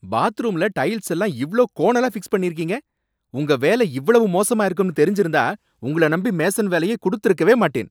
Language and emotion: Tamil, angry